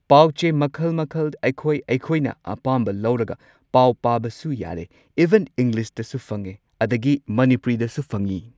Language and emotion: Manipuri, neutral